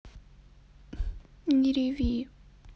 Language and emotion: Russian, sad